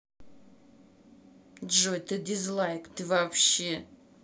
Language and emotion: Russian, angry